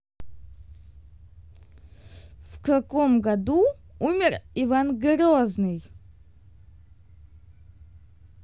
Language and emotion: Russian, neutral